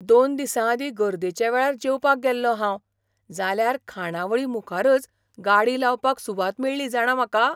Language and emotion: Goan Konkani, surprised